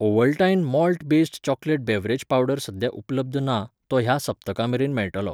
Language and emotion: Goan Konkani, neutral